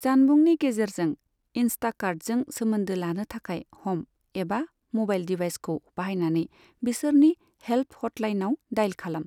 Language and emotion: Bodo, neutral